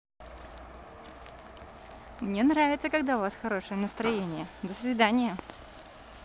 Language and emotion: Russian, positive